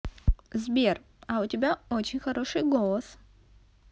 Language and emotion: Russian, positive